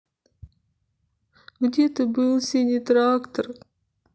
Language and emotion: Russian, sad